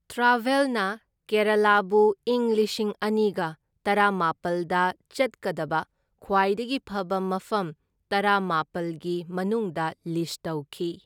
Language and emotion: Manipuri, neutral